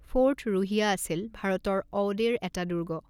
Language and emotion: Assamese, neutral